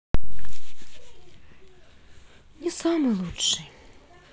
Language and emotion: Russian, sad